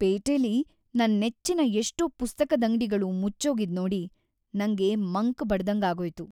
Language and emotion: Kannada, sad